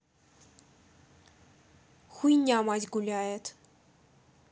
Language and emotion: Russian, neutral